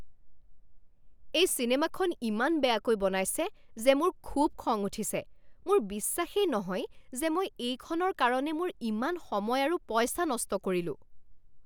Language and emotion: Assamese, angry